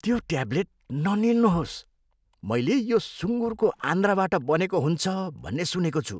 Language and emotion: Nepali, disgusted